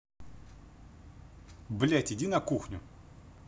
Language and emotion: Russian, angry